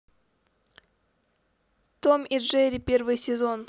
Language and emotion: Russian, neutral